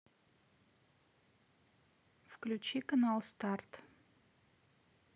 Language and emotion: Russian, neutral